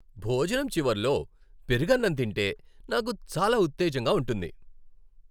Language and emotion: Telugu, happy